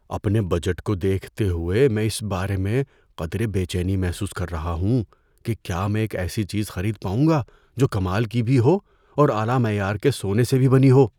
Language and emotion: Urdu, fearful